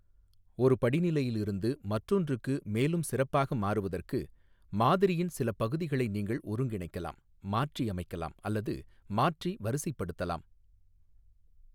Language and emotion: Tamil, neutral